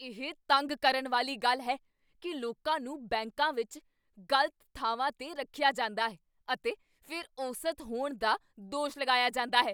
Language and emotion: Punjabi, angry